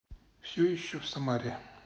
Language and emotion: Russian, neutral